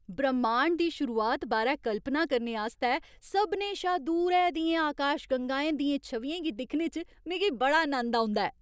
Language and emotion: Dogri, happy